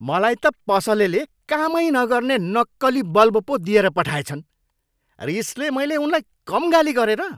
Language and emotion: Nepali, angry